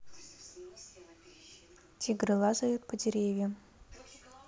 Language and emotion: Russian, neutral